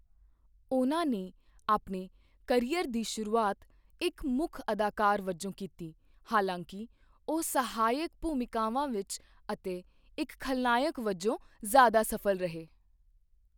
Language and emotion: Punjabi, neutral